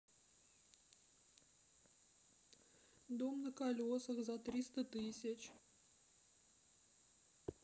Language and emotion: Russian, sad